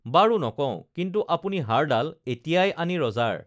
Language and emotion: Assamese, neutral